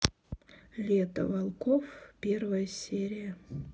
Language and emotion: Russian, neutral